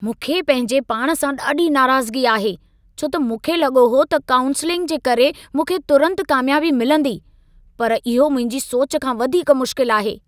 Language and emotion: Sindhi, angry